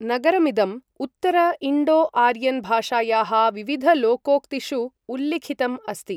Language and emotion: Sanskrit, neutral